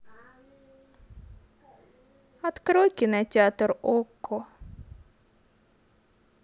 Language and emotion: Russian, sad